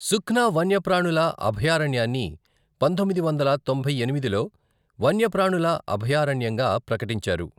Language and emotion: Telugu, neutral